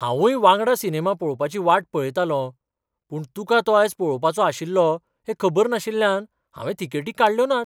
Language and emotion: Goan Konkani, surprised